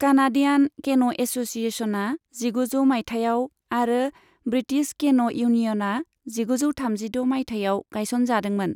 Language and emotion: Bodo, neutral